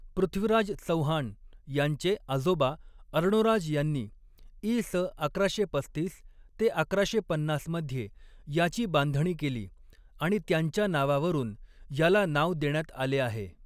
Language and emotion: Marathi, neutral